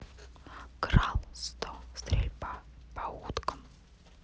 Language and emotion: Russian, neutral